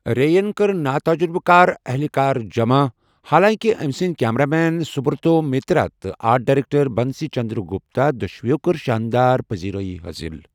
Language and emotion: Kashmiri, neutral